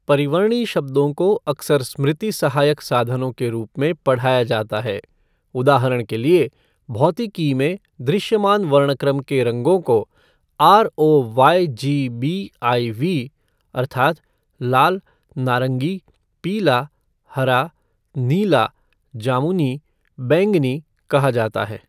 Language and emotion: Hindi, neutral